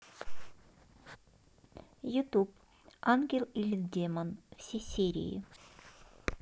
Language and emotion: Russian, neutral